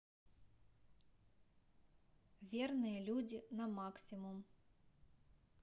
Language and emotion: Russian, neutral